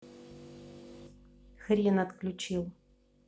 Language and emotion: Russian, angry